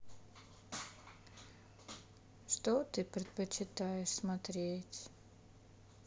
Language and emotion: Russian, sad